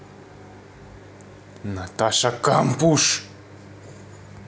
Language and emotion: Russian, angry